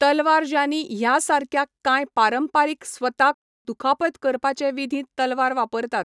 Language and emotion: Goan Konkani, neutral